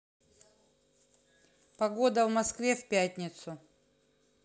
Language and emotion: Russian, neutral